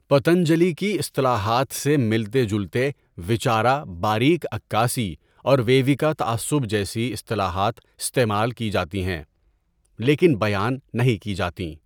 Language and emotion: Urdu, neutral